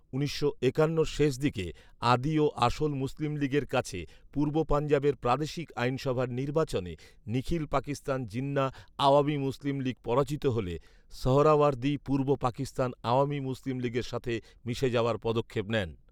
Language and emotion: Bengali, neutral